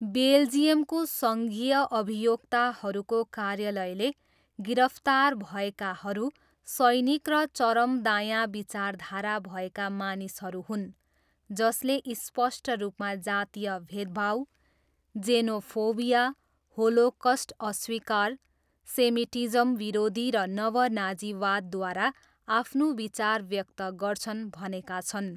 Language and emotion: Nepali, neutral